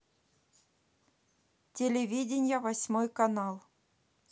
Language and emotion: Russian, neutral